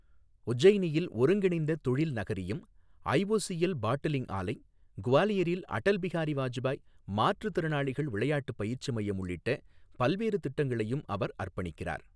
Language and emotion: Tamil, neutral